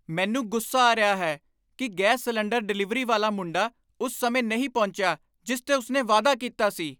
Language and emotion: Punjabi, angry